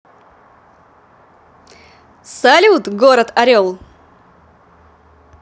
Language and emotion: Russian, positive